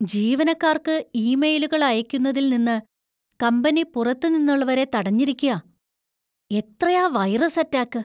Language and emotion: Malayalam, fearful